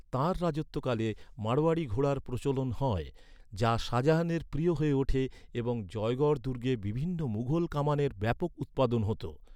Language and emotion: Bengali, neutral